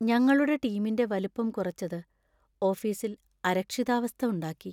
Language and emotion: Malayalam, sad